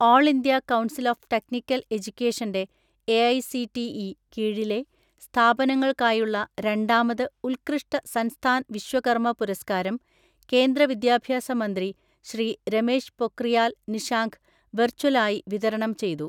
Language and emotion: Malayalam, neutral